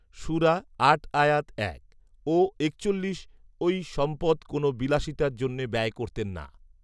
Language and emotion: Bengali, neutral